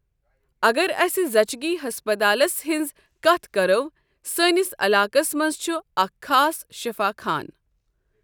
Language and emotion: Kashmiri, neutral